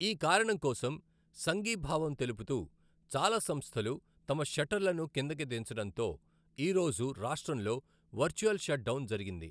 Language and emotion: Telugu, neutral